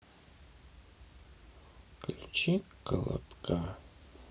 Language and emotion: Russian, sad